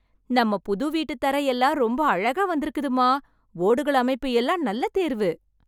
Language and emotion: Tamil, happy